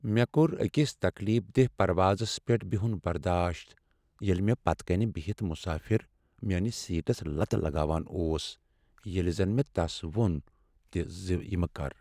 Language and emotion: Kashmiri, sad